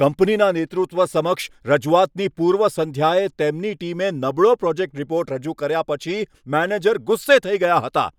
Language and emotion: Gujarati, angry